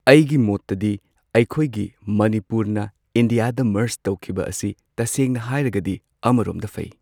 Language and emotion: Manipuri, neutral